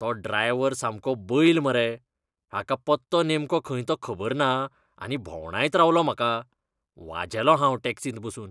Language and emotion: Goan Konkani, disgusted